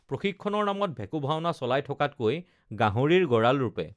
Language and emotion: Assamese, neutral